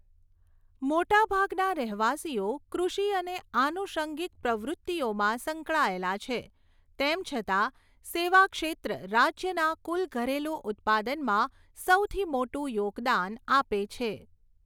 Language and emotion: Gujarati, neutral